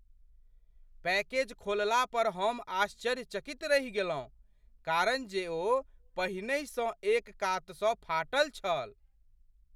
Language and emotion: Maithili, surprised